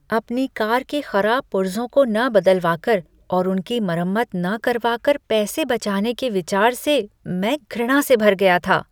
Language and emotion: Hindi, disgusted